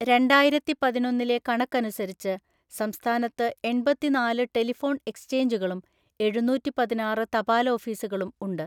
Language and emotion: Malayalam, neutral